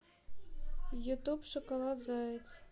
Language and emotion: Russian, neutral